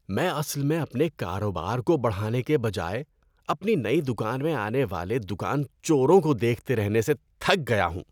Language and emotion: Urdu, disgusted